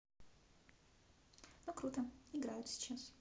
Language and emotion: Russian, neutral